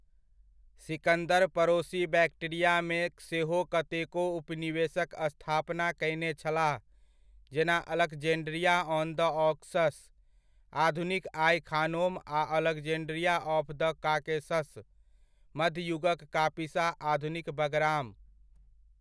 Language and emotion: Maithili, neutral